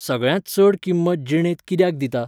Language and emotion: Goan Konkani, neutral